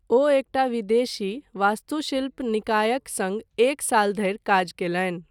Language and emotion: Maithili, neutral